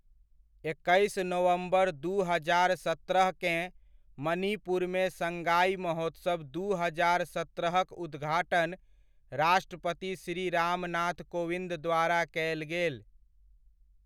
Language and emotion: Maithili, neutral